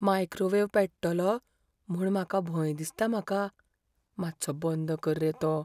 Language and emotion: Goan Konkani, fearful